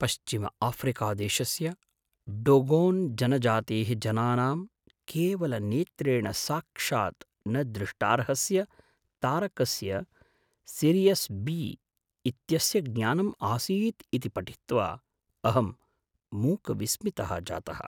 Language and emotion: Sanskrit, surprised